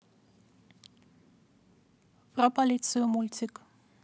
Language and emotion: Russian, neutral